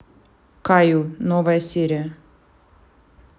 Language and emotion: Russian, neutral